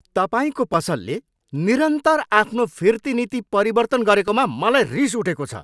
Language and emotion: Nepali, angry